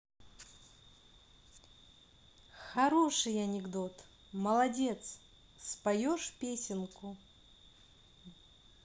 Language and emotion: Russian, positive